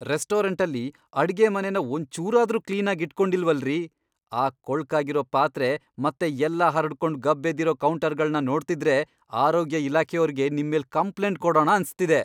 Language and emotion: Kannada, angry